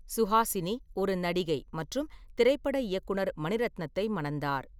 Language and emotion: Tamil, neutral